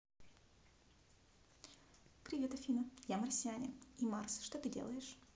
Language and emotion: Russian, positive